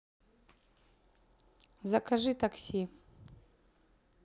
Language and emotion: Russian, neutral